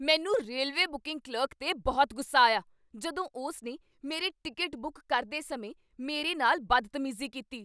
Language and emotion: Punjabi, angry